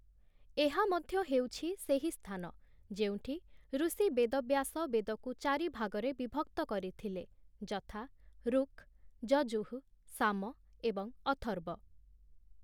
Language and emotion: Odia, neutral